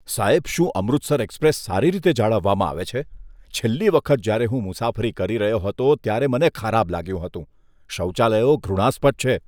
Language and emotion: Gujarati, disgusted